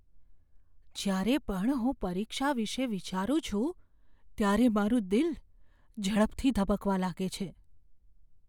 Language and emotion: Gujarati, fearful